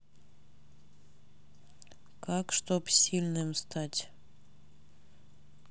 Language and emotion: Russian, neutral